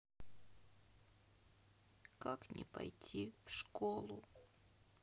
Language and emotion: Russian, sad